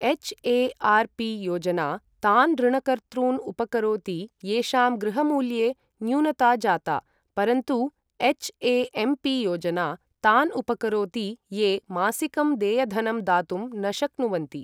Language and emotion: Sanskrit, neutral